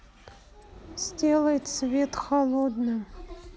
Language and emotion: Russian, sad